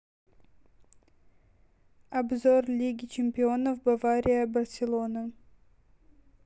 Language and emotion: Russian, neutral